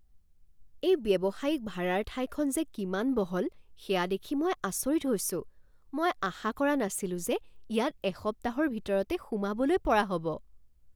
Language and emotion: Assamese, surprised